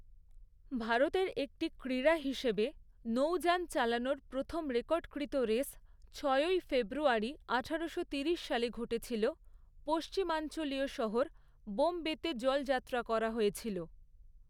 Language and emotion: Bengali, neutral